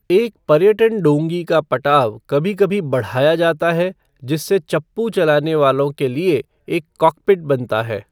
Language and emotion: Hindi, neutral